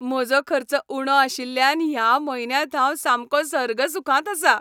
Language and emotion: Goan Konkani, happy